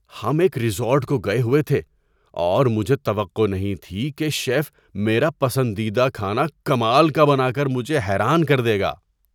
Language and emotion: Urdu, surprised